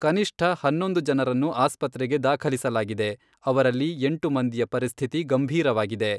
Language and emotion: Kannada, neutral